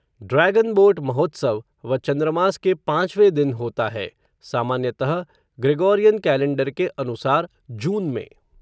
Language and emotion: Hindi, neutral